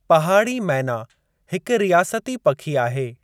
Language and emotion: Sindhi, neutral